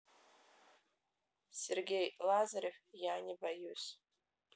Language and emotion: Russian, neutral